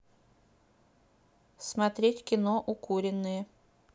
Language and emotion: Russian, neutral